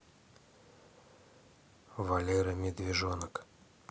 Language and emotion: Russian, neutral